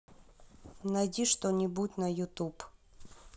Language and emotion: Russian, neutral